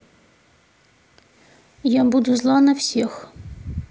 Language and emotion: Russian, neutral